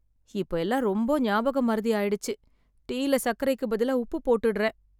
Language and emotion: Tamil, sad